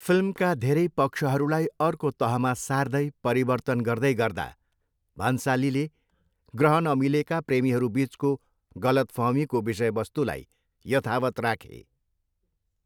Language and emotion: Nepali, neutral